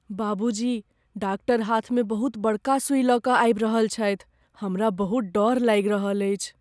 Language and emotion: Maithili, fearful